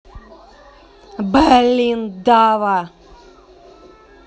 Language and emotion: Russian, angry